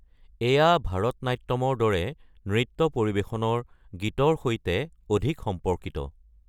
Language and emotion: Assamese, neutral